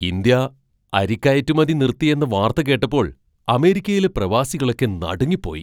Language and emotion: Malayalam, surprised